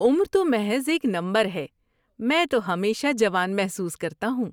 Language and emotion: Urdu, happy